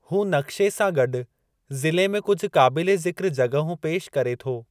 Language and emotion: Sindhi, neutral